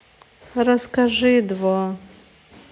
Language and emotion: Russian, sad